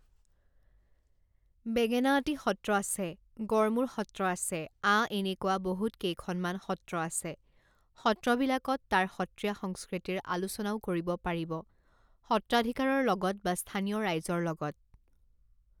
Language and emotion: Assamese, neutral